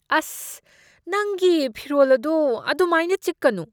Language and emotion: Manipuri, disgusted